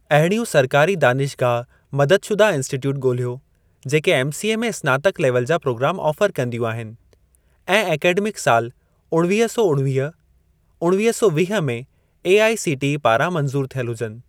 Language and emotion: Sindhi, neutral